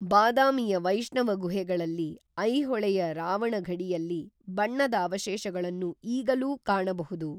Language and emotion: Kannada, neutral